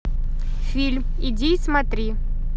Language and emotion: Russian, neutral